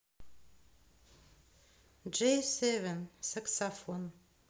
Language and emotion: Russian, neutral